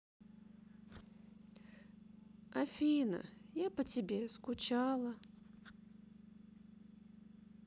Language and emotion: Russian, sad